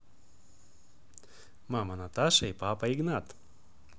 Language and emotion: Russian, positive